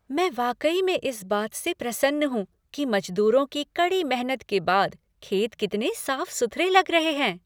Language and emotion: Hindi, happy